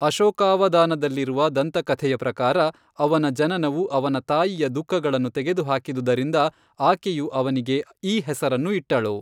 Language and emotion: Kannada, neutral